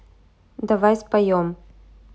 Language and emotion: Russian, neutral